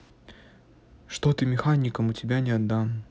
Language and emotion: Russian, neutral